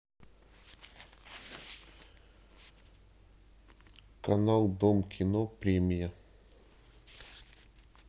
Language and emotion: Russian, neutral